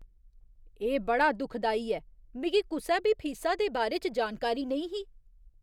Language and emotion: Dogri, disgusted